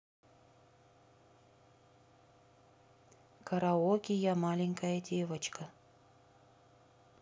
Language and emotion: Russian, neutral